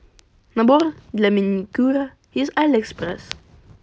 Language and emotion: Russian, positive